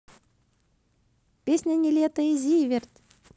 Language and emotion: Russian, positive